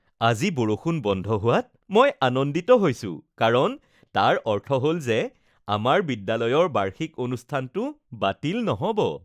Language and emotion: Assamese, happy